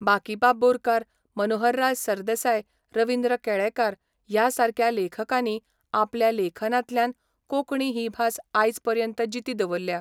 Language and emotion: Goan Konkani, neutral